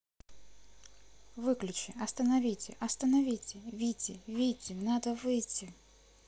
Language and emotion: Russian, neutral